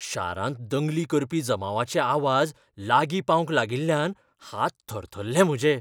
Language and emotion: Goan Konkani, fearful